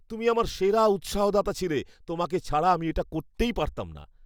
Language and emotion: Bengali, happy